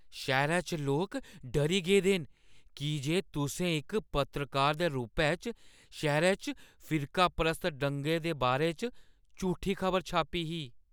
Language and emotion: Dogri, fearful